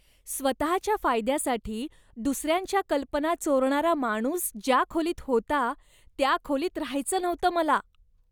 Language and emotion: Marathi, disgusted